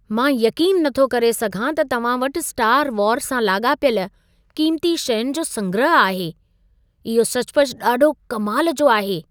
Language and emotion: Sindhi, surprised